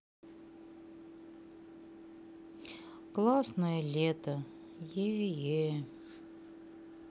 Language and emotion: Russian, sad